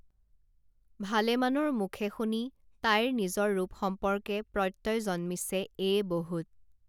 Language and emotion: Assamese, neutral